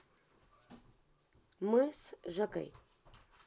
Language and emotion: Russian, neutral